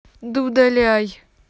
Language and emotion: Russian, angry